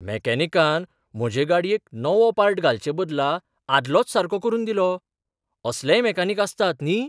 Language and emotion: Goan Konkani, surprised